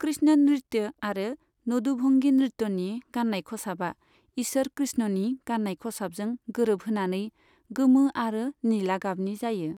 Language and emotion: Bodo, neutral